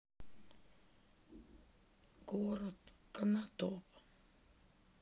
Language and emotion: Russian, sad